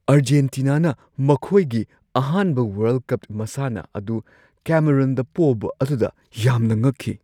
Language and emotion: Manipuri, surprised